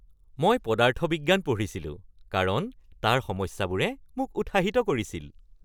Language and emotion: Assamese, happy